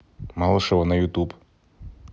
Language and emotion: Russian, neutral